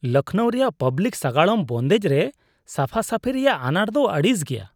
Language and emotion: Santali, disgusted